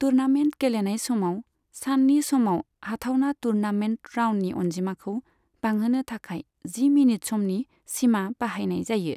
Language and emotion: Bodo, neutral